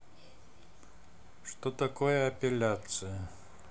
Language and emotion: Russian, neutral